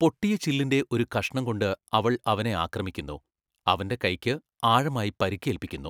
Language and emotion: Malayalam, neutral